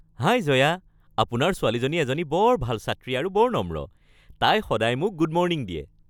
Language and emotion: Assamese, happy